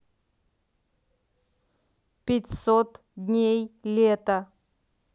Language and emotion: Russian, neutral